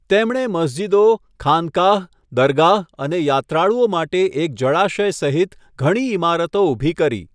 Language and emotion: Gujarati, neutral